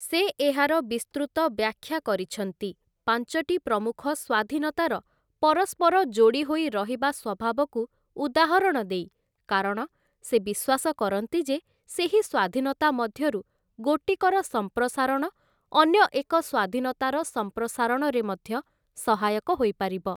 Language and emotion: Odia, neutral